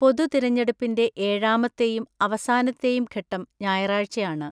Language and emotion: Malayalam, neutral